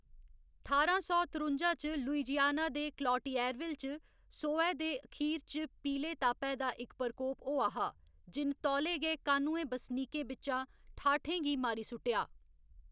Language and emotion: Dogri, neutral